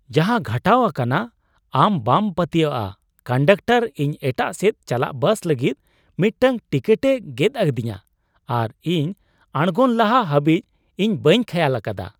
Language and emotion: Santali, surprised